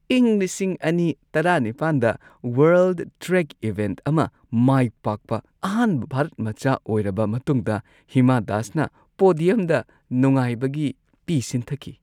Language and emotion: Manipuri, happy